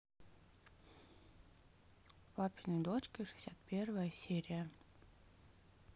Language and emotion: Russian, neutral